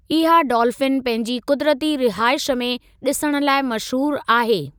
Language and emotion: Sindhi, neutral